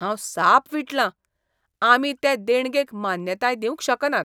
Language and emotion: Goan Konkani, disgusted